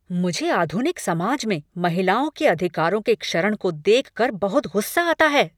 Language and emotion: Hindi, angry